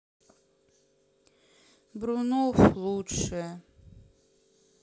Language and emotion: Russian, sad